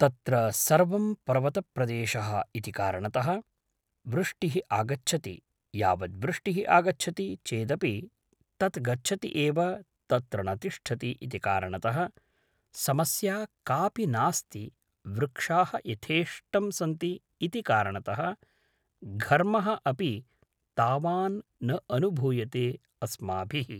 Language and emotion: Sanskrit, neutral